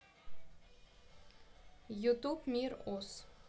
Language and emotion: Russian, neutral